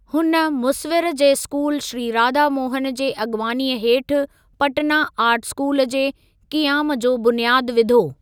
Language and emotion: Sindhi, neutral